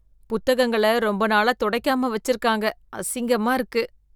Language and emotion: Tamil, disgusted